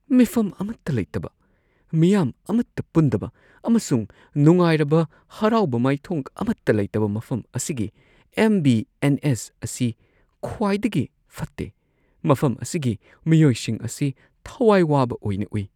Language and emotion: Manipuri, sad